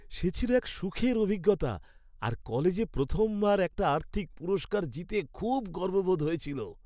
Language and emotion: Bengali, happy